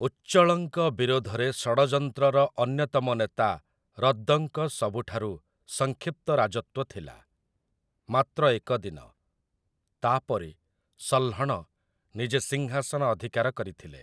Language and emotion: Odia, neutral